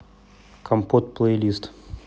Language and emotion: Russian, neutral